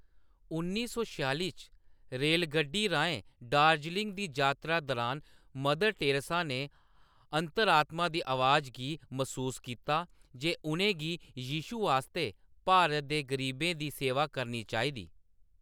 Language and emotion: Dogri, neutral